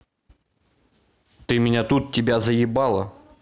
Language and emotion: Russian, neutral